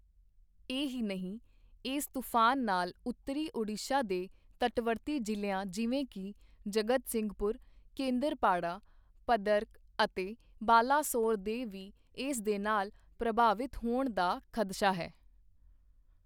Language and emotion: Punjabi, neutral